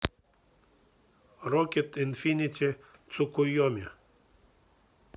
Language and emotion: Russian, neutral